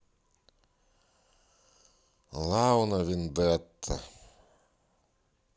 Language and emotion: Russian, neutral